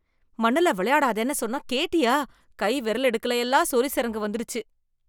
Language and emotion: Tamil, disgusted